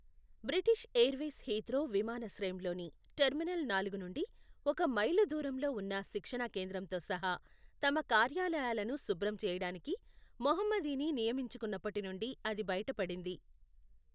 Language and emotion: Telugu, neutral